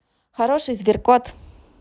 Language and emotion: Russian, positive